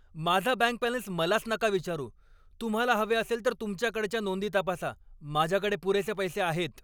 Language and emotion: Marathi, angry